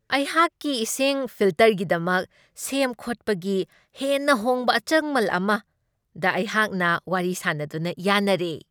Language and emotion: Manipuri, happy